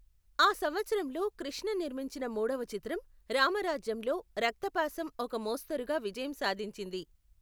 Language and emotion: Telugu, neutral